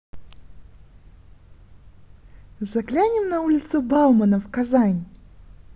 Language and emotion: Russian, positive